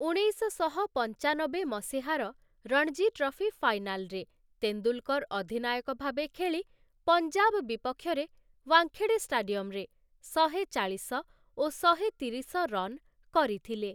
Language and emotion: Odia, neutral